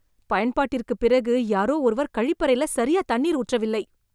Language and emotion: Tamil, disgusted